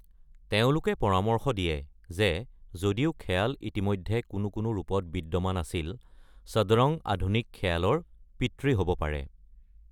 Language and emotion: Assamese, neutral